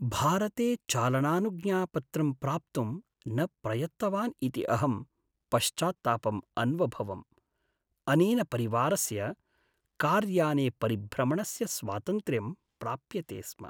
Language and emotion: Sanskrit, sad